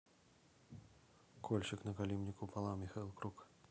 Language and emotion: Russian, neutral